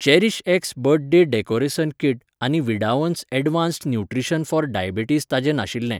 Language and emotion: Goan Konkani, neutral